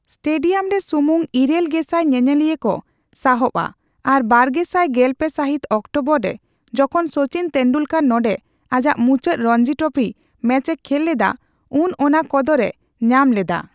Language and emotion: Santali, neutral